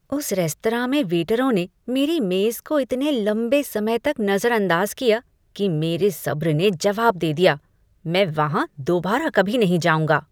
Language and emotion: Hindi, disgusted